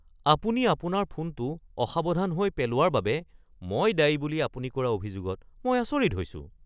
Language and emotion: Assamese, surprised